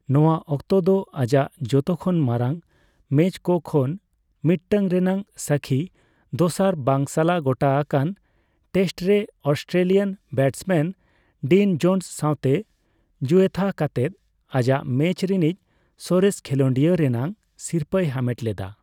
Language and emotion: Santali, neutral